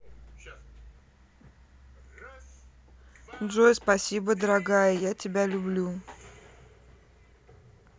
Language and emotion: Russian, neutral